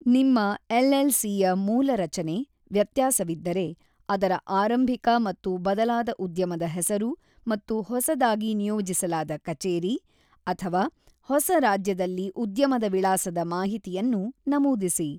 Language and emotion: Kannada, neutral